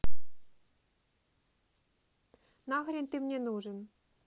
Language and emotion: Russian, angry